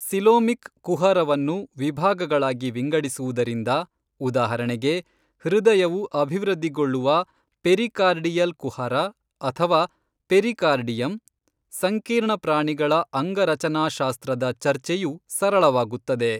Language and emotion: Kannada, neutral